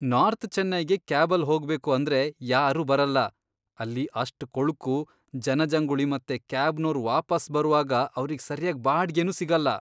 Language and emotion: Kannada, disgusted